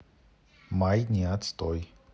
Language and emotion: Russian, neutral